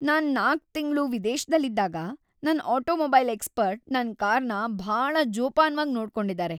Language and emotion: Kannada, happy